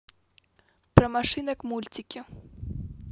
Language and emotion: Russian, neutral